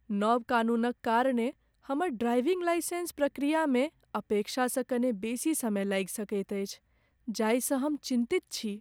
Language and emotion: Maithili, sad